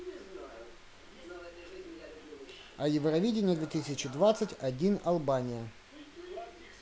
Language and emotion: Russian, neutral